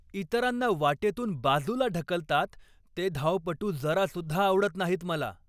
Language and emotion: Marathi, angry